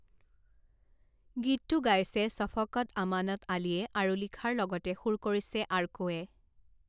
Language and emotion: Assamese, neutral